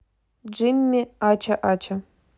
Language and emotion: Russian, neutral